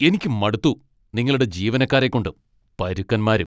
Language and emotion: Malayalam, angry